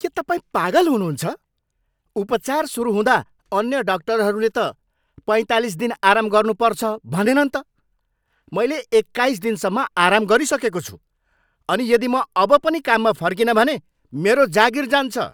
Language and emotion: Nepali, angry